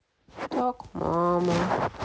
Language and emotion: Russian, sad